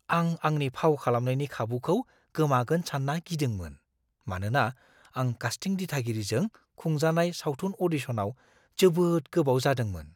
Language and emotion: Bodo, fearful